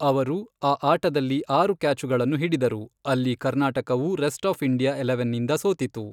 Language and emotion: Kannada, neutral